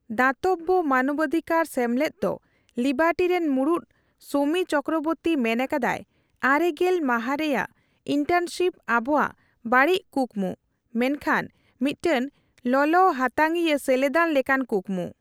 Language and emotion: Santali, neutral